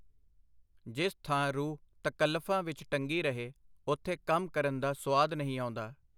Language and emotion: Punjabi, neutral